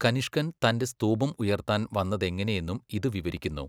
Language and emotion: Malayalam, neutral